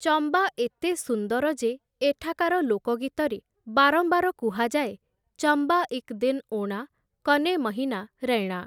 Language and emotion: Odia, neutral